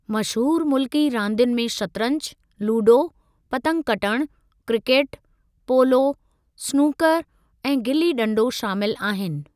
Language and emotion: Sindhi, neutral